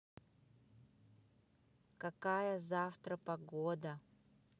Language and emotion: Russian, neutral